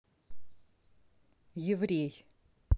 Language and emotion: Russian, neutral